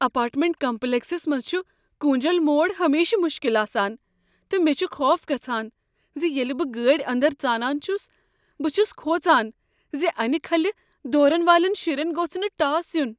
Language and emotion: Kashmiri, fearful